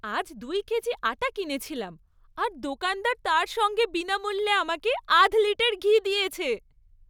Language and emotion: Bengali, happy